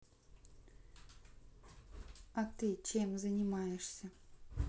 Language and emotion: Russian, neutral